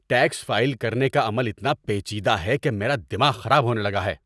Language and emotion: Urdu, angry